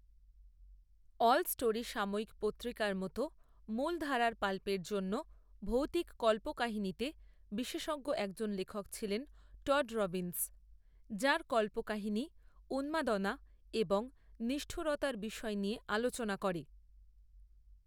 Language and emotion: Bengali, neutral